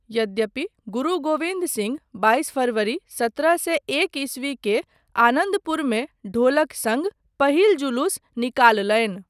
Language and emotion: Maithili, neutral